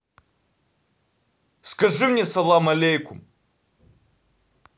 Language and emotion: Russian, angry